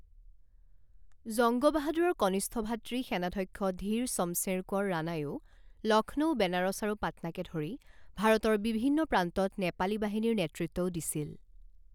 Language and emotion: Assamese, neutral